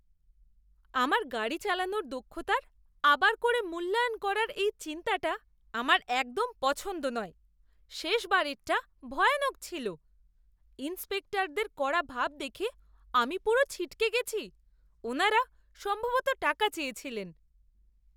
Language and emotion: Bengali, disgusted